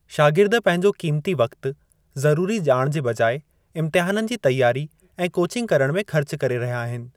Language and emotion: Sindhi, neutral